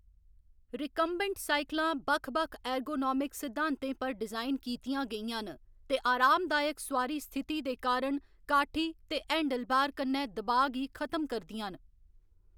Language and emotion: Dogri, neutral